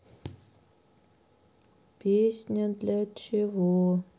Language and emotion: Russian, sad